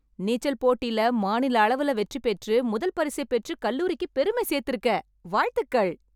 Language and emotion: Tamil, happy